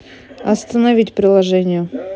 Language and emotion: Russian, neutral